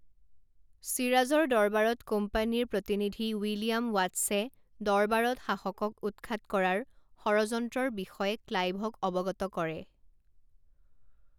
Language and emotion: Assamese, neutral